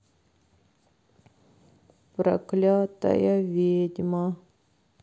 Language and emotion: Russian, sad